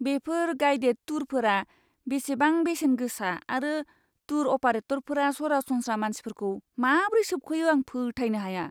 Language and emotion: Bodo, disgusted